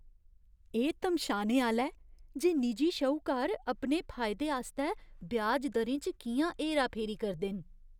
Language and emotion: Dogri, disgusted